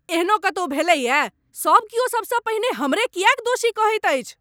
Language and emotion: Maithili, angry